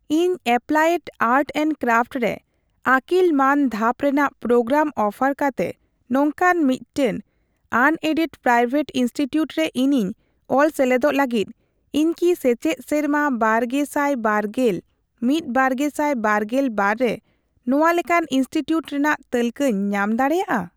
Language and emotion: Santali, neutral